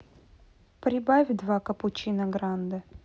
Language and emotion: Russian, neutral